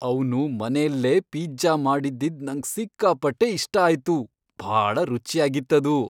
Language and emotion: Kannada, happy